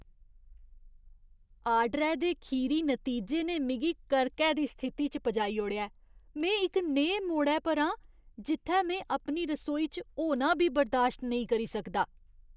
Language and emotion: Dogri, disgusted